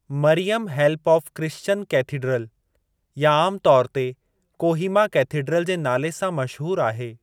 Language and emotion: Sindhi, neutral